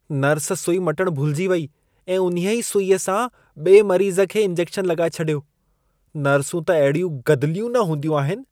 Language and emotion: Sindhi, disgusted